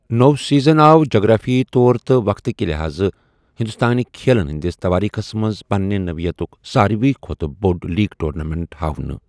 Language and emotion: Kashmiri, neutral